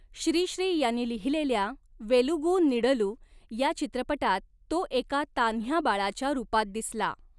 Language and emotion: Marathi, neutral